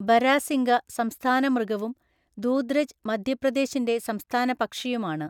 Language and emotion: Malayalam, neutral